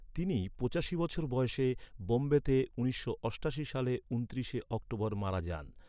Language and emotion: Bengali, neutral